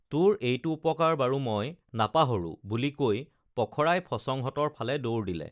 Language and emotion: Assamese, neutral